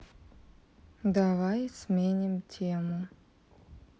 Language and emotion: Russian, neutral